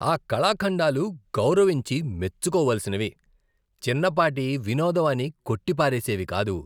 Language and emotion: Telugu, disgusted